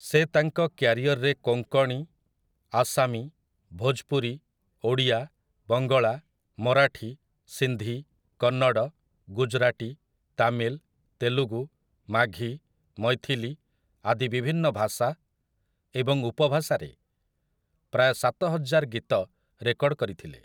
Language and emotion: Odia, neutral